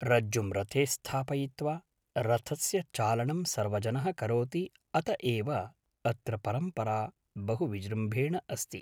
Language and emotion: Sanskrit, neutral